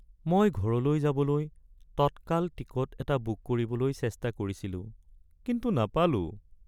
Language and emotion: Assamese, sad